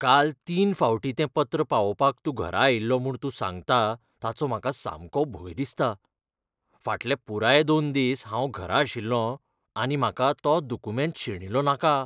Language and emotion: Goan Konkani, fearful